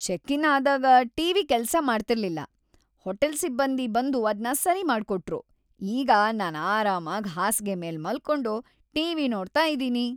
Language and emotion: Kannada, happy